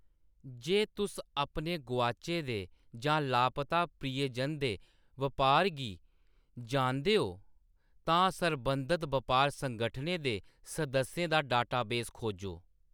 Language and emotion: Dogri, neutral